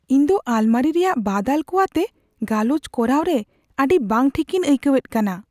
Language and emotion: Santali, fearful